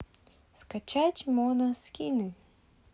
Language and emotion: Russian, positive